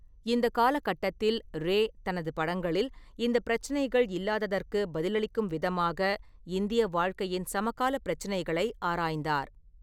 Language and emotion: Tamil, neutral